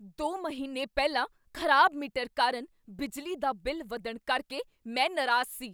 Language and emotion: Punjabi, angry